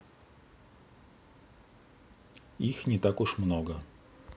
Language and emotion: Russian, neutral